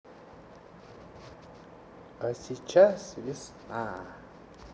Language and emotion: Russian, positive